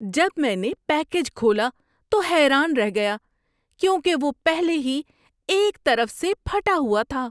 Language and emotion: Urdu, surprised